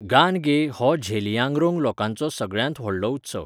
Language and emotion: Goan Konkani, neutral